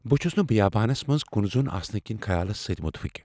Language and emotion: Kashmiri, fearful